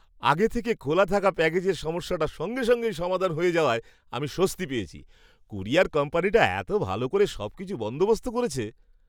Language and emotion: Bengali, happy